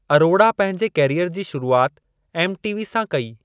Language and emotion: Sindhi, neutral